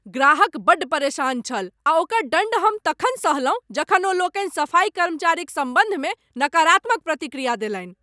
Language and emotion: Maithili, angry